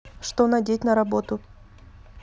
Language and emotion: Russian, neutral